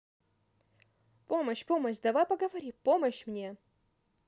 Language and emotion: Russian, positive